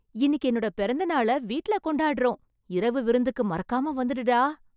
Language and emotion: Tamil, happy